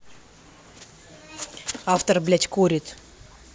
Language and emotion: Russian, angry